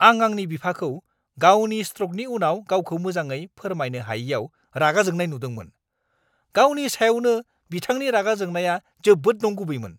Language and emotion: Bodo, angry